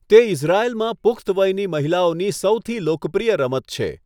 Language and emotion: Gujarati, neutral